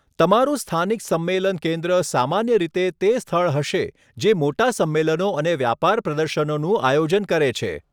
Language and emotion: Gujarati, neutral